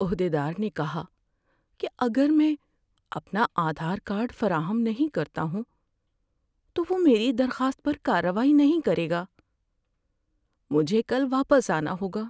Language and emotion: Urdu, sad